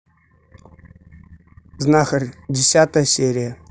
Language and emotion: Russian, neutral